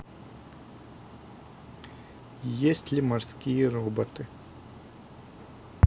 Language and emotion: Russian, neutral